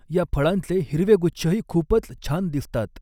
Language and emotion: Marathi, neutral